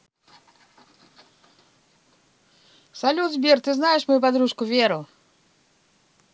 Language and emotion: Russian, positive